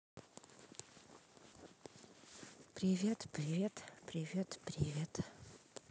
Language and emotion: Russian, neutral